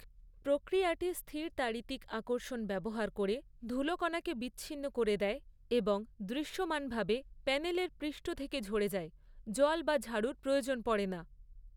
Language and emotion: Bengali, neutral